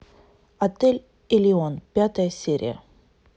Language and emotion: Russian, neutral